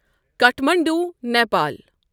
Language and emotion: Kashmiri, neutral